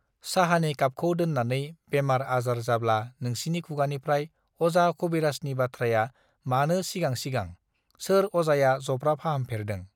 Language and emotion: Bodo, neutral